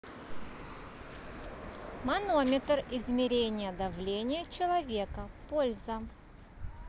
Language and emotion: Russian, neutral